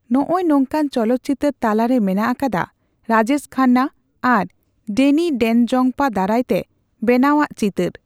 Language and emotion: Santali, neutral